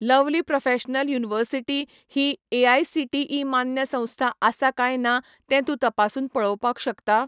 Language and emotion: Goan Konkani, neutral